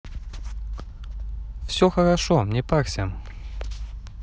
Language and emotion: Russian, positive